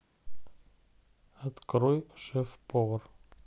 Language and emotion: Russian, neutral